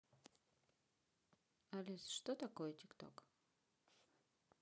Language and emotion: Russian, neutral